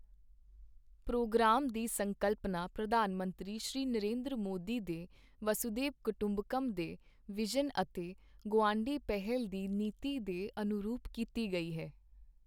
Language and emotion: Punjabi, neutral